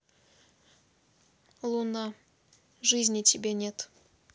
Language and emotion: Russian, neutral